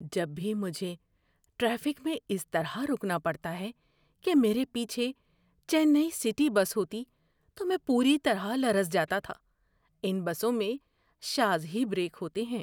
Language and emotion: Urdu, fearful